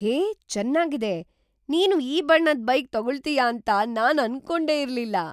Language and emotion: Kannada, surprised